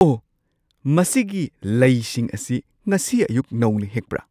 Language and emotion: Manipuri, surprised